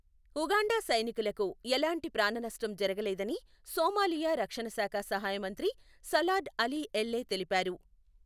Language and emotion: Telugu, neutral